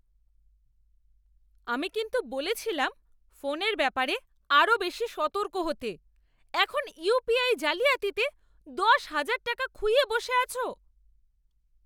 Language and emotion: Bengali, angry